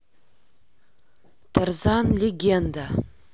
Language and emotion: Russian, neutral